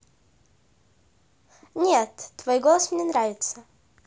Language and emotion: Russian, positive